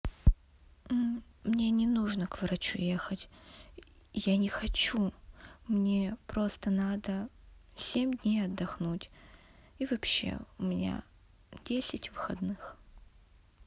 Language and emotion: Russian, sad